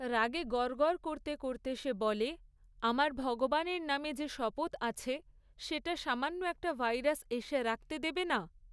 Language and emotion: Bengali, neutral